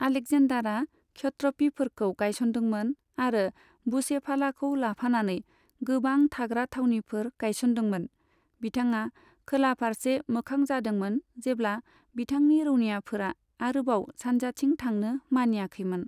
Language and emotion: Bodo, neutral